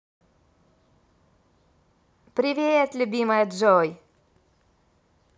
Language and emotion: Russian, positive